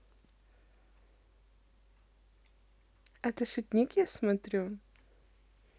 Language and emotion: Russian, positive